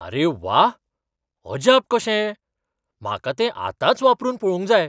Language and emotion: Goan Konkani, surprised